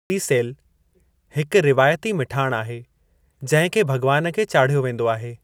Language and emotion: Sindhi, neutral